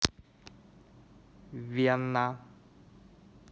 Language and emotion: Russian, neutral